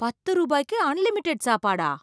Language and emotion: Tamil, surprised